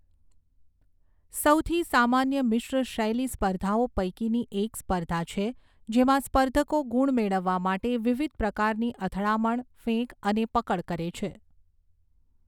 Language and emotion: Gujarati, neutral